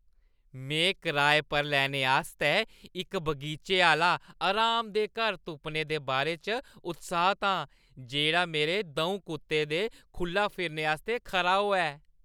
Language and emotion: Dogri, happy